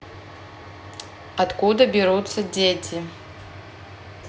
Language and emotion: Russian, neutral